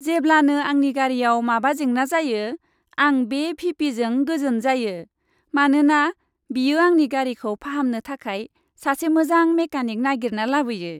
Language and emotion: Bodo, happy